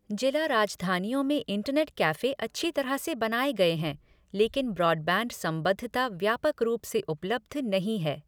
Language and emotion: Hindi, neutral